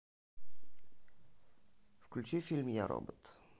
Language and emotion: Russian, neutral